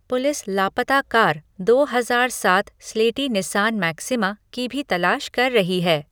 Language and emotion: Hindi, neutral